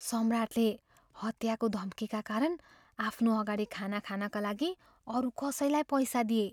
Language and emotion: Nepali, fearful